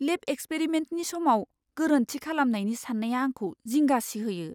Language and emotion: Bodo, fearful